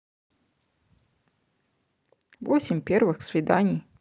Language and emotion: Russian, neutral